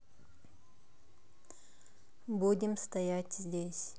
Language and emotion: Russian, neutral